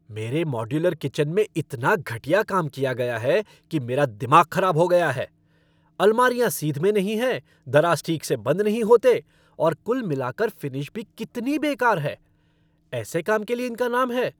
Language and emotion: Hindi, angry